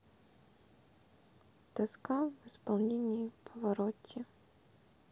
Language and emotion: Russian, sad